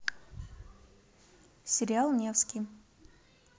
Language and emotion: Russian, neutral